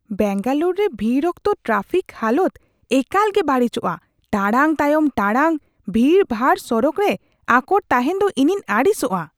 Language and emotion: Santali, disgusted